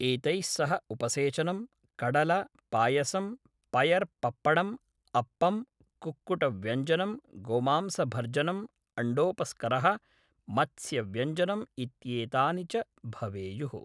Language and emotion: Sanskrit, neutral